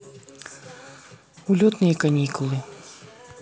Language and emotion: Russian, neutral